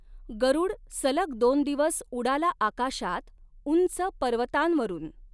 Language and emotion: Marathi, neutral